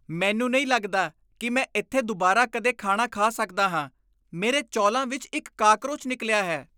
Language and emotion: Punjabi, disgusted